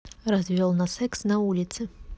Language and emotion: Russian, neutral